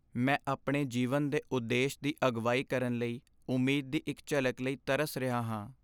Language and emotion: Punjabi, sad